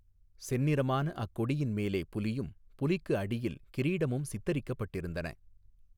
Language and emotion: Tamil, neutral